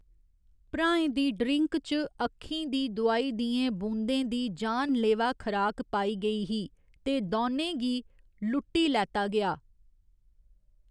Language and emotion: Dogri, neutral